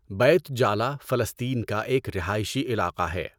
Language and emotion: Urdu, neutral